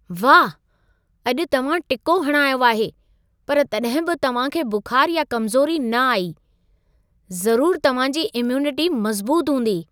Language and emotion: Sindhi, surprised